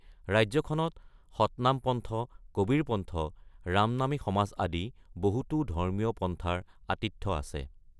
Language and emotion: Assamese, neutral